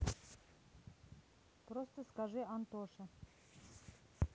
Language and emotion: Russian, neutral